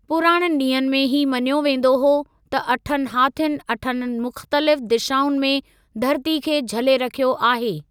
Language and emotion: Sindhi, neutral